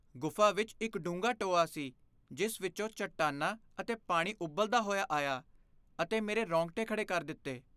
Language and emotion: Punjabi, fearful